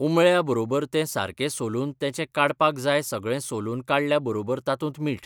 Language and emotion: Goan Konkani, neutral